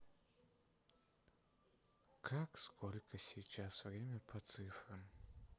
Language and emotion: Russian, sad